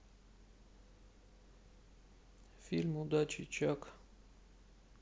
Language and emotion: Russian, sad